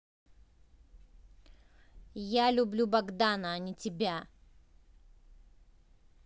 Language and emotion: Russian, angry